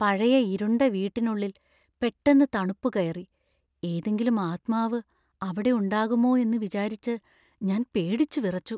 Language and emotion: Malayalam, fearful